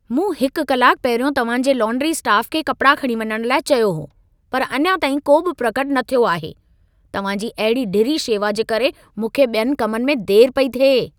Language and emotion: Sindhi, angry